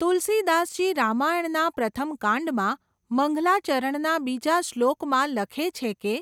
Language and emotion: Gujarati, neutral